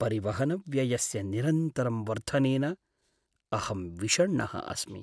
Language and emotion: Sanskrit, sad